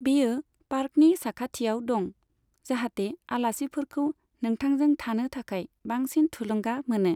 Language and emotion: Bodo, neutral